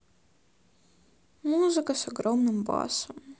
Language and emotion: Russian, sad